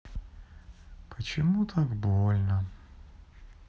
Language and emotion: Russian, sad